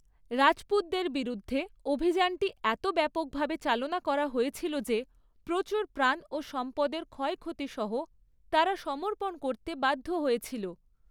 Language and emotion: Bengali, neutral